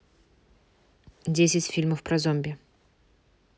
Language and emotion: Russian, neutral